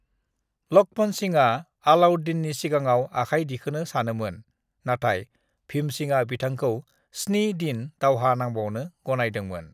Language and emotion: Bodo, neutral